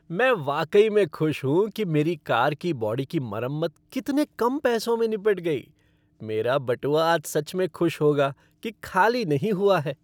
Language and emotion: Hindi, happy